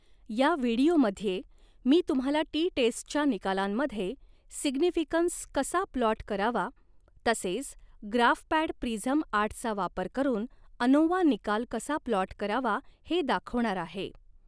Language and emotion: Marathi, neutral